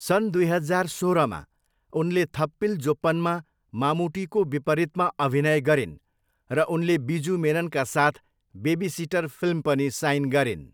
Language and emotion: Nepali, neutral